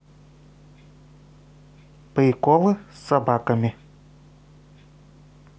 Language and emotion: Russian, neutral